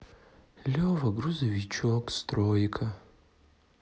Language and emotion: Russian, sad